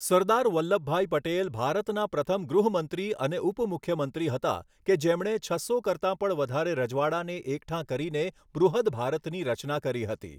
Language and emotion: Gujarati, neutral